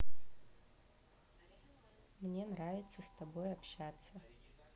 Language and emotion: Russian, neutral